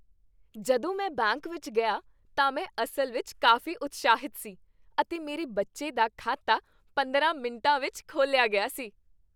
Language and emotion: Punjabi, happy